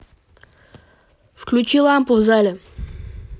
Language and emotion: Russian, angry